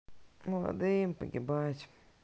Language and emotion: Russian, sad